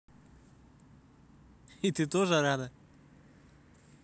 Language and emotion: Russian, positive